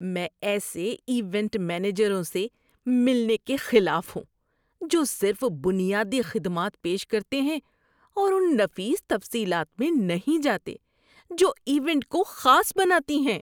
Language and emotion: Urdu, disgusted